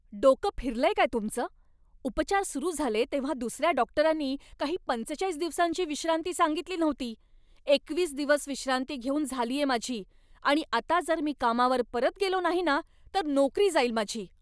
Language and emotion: Marathi, angry